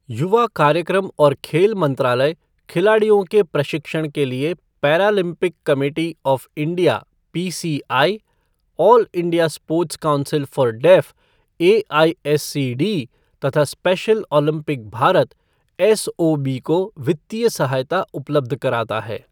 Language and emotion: Hindi, neutral